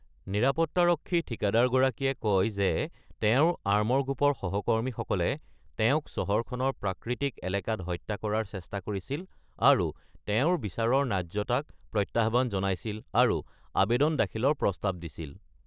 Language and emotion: Assamese, neutral